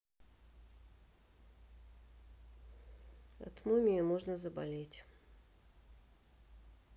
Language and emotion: Russian, sad